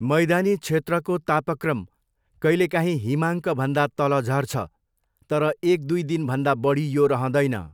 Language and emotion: Nepali, neutral